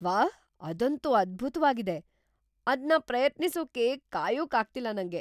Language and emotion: Kannada, surprised